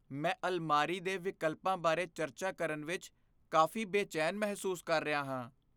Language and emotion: Punjabi, fearful